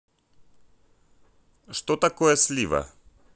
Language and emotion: Russian, neutral